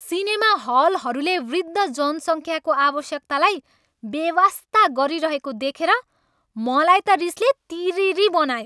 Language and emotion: Nepali, angry